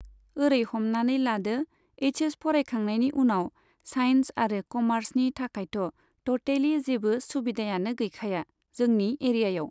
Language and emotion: Bodo, neutral